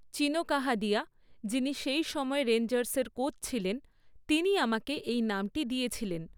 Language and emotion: Bengali, neutral